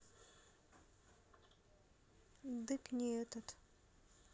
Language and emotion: Russian, neutral